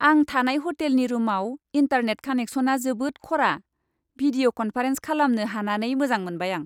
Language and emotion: Bodo, happy